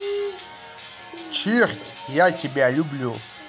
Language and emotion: Russian, positive